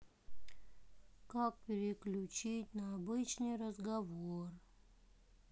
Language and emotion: Russian, sad